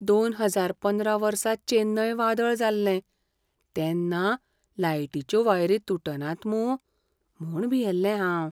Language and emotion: Goan Konkani, fearful